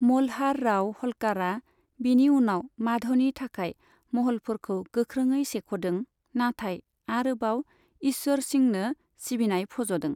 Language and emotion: Bodo, neutral